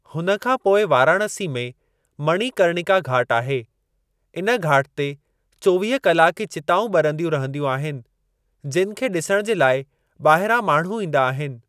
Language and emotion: Sindhi, neutral